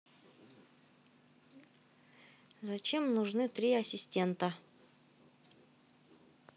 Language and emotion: Russian, neutral